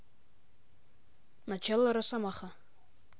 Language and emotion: Russian, neutral